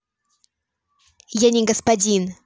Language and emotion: Russian, angry